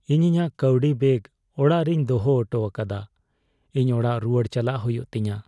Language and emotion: Santali, sad